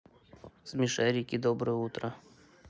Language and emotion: Russian, neutral